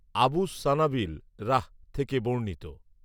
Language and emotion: Bengali, neutral